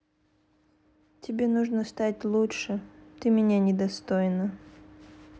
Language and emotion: Russian, sad